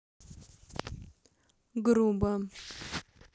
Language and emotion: Russian, neutral